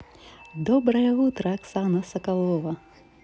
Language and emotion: Russian, positive